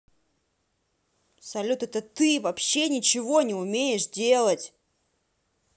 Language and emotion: Russian, angry